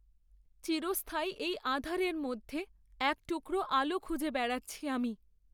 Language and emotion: Bengali, sad